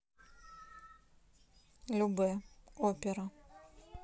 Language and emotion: Russian, neutral